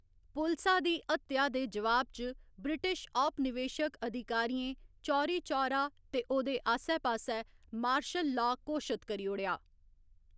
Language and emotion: Dogri, neutral